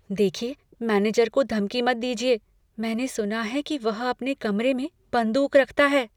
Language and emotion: Hindi, fearful